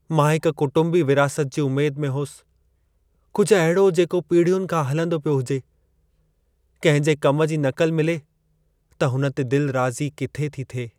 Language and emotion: Sindhi, sad